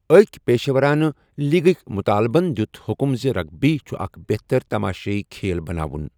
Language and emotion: Kashmiri, neutral